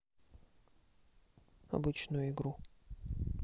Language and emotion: Russian, neutral